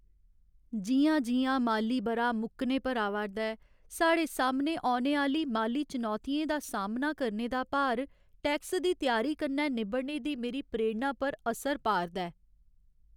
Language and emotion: Dogri, sad